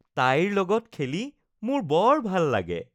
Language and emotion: Assamese, happy